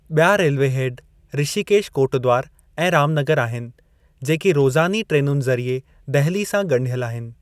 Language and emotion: Sindhi, neutral